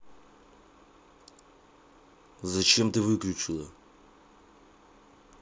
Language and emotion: Russian, angry